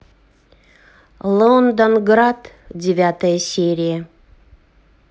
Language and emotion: Russian, neutral